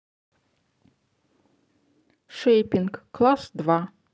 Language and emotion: Russian, neutral